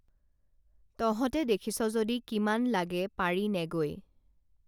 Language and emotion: Assamese, neutral